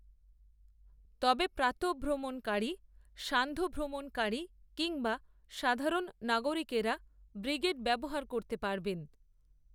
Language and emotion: Bengali, neutral